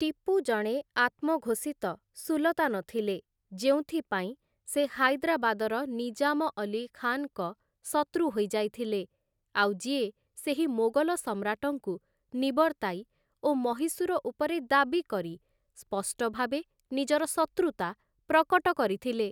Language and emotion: Odia, neutral